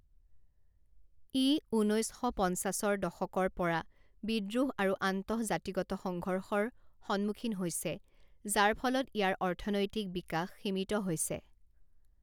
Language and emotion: Assamese, neutral